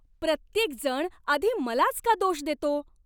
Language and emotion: Marathi, angry